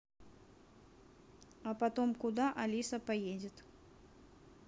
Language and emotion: Russian, neutral